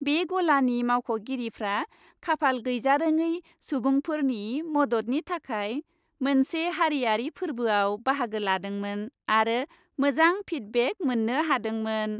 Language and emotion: Bodo, happy